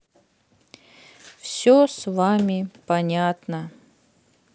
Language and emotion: Russian, sad